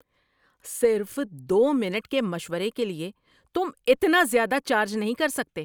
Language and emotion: Urdu, angry